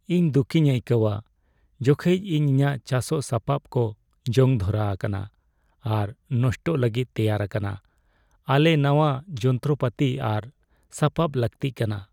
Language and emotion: Santali, sad